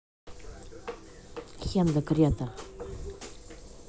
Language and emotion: Russian, angry